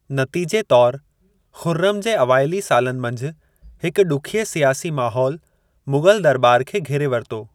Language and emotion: Sindhi, neutral